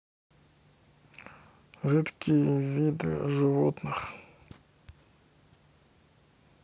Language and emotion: Russian, neutral